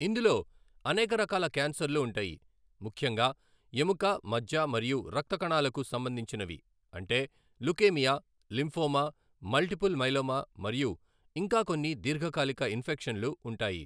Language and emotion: Telugu, neutral